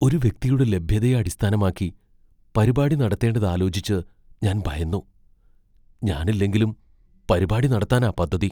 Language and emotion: Malayalam, fearful